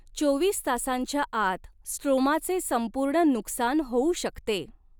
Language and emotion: Marathi, neutral